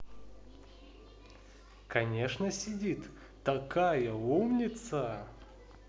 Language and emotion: Russian, positive